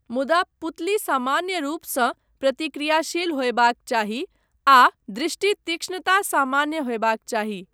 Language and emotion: Maithili, neutral